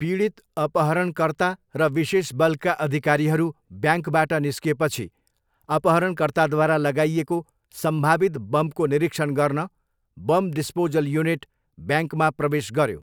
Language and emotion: Nepali, neutral